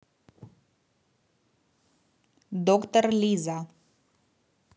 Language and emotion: Russian, neutral